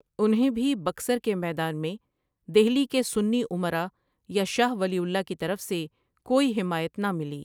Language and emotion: Urdu, neutral